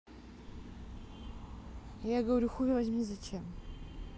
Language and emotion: Russian, neutral